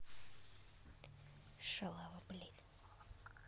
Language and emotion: Russian, angry